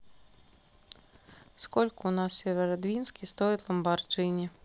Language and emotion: Russian, neutral